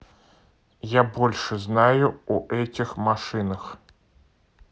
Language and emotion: Russian, neutral